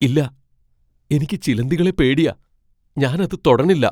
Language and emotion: Malayalam, fearful